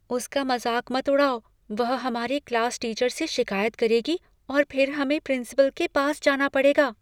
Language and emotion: Hindi, fearful